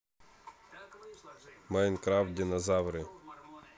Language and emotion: Russian, neutral